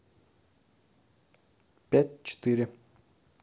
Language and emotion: Russian, neutral